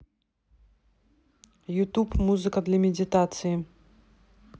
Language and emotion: Russian, neutral